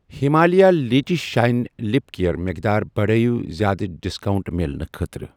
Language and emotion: Kashmiri, neutral